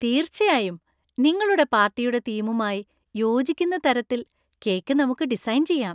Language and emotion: Malayalam, happy